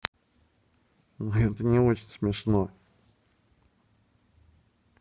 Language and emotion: Russian, neutral